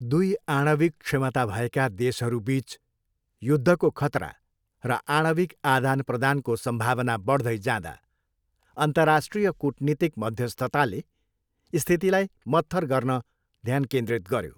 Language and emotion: Nepali, neutral